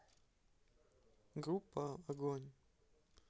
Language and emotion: Russian, neutral